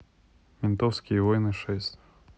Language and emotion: Russian, neutral